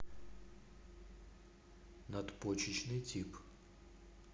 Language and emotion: Russian, neutral